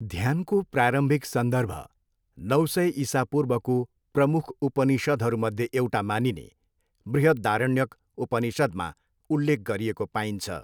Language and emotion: Nepali, neutral